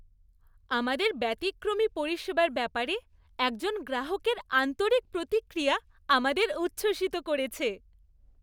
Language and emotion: Bengali, happy